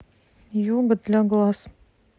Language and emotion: Russian, neutral